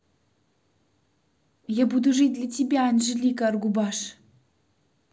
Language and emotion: Russian, positive